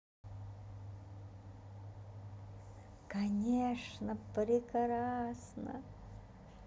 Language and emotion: Russian, positive